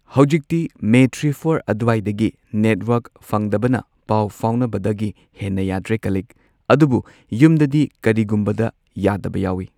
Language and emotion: Manipuri, neutral